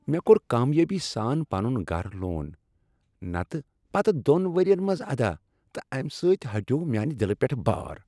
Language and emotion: Kashmiri, happy